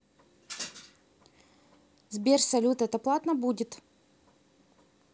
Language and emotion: Russian, neutral